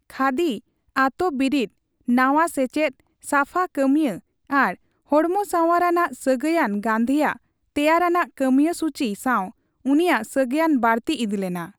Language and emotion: Santali, neutral